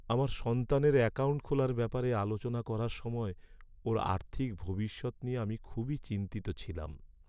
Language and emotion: Bengali, sad